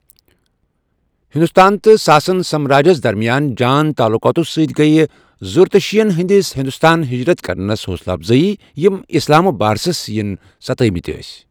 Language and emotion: Kashmiri, neutral